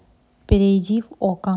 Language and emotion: Russian, neutral